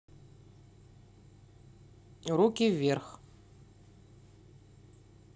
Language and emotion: Russian, neutral